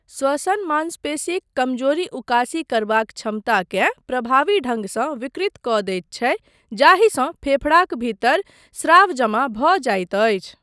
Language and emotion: Maithili, neutral